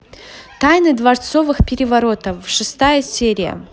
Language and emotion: Russian, positive